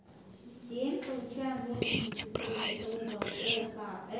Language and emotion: Russian, neutral